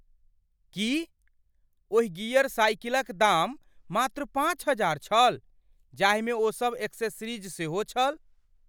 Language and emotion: Maithili, surprised